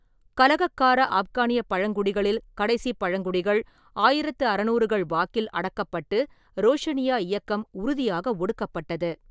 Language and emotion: Tamil, neutral